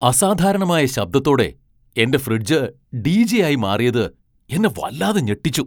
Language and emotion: Malayalam, surprised